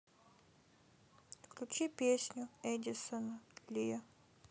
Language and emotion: Russian, sad